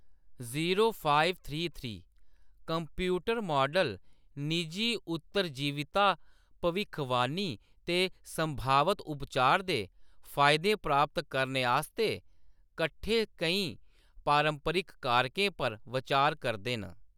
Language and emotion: Dogri, neutral